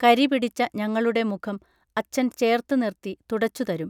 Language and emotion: Malayalam, neutral